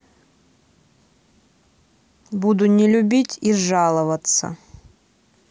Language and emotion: Russian, neutral